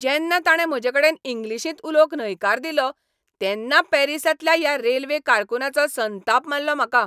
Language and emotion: Goan Konkani, angry